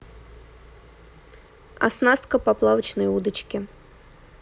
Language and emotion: Russian, neutral